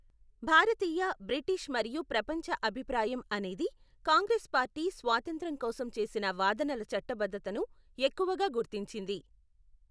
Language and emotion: Telugu, neutral